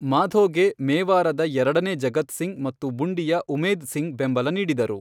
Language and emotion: Kannada, neutral